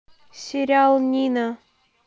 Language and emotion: Russian, neutral